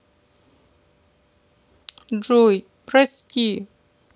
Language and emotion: Russian, sad